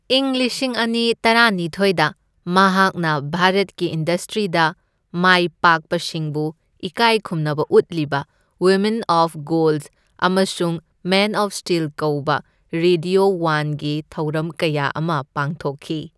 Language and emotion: Manipuri, neutral